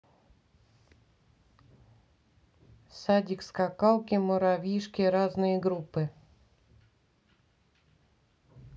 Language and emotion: Russian, neutral